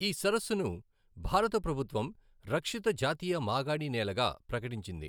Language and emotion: Telugu, neutral